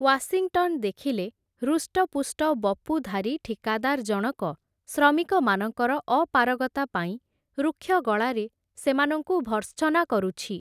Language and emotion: Odia, neutral